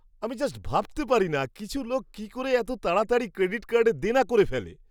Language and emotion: Bengali, surprised